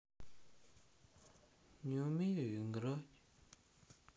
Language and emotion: Russian, sad